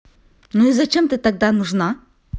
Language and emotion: Russian, neutral